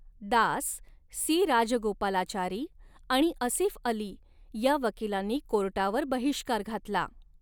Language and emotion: Marathi, neutral